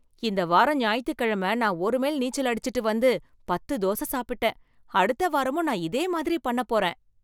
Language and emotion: Tamil, happy